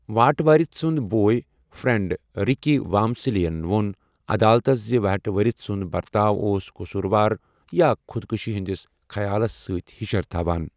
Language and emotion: Kashmiri, neutral